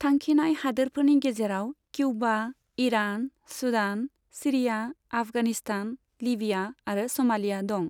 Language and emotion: Bodo, neutral